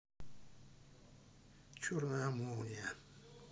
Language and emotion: Russian, sad